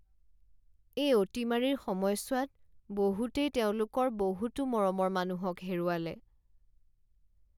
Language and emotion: Assamese, sad